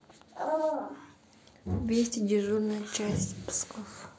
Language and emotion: Russian, neutral